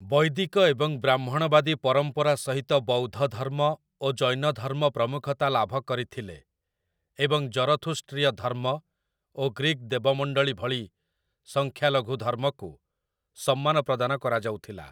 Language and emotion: Odia, neutral